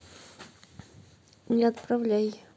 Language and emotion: Russian, neutral